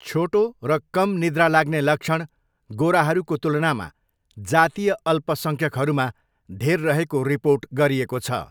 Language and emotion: Nepali, neutral